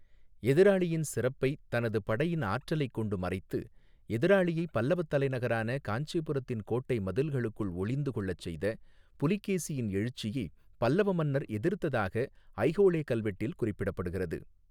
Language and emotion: Tamil, neutral